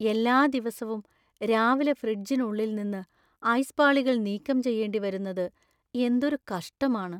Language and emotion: Malayalam, sad